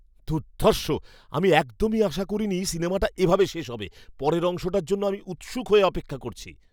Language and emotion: Bengali, surprised